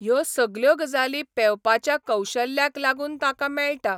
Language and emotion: Goan Konkani, neutral